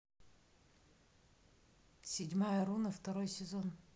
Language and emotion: Russian, neutral